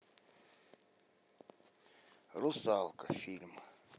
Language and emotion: Russian, neutral